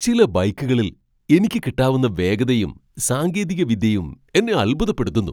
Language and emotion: Malayalam, surprised